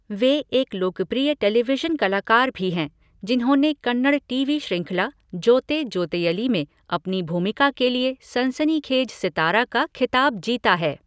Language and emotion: Hindi, neutral